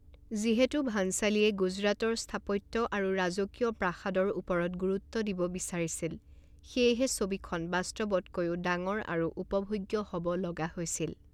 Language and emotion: Assamese, neutral